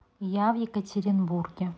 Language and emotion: Russian, neutral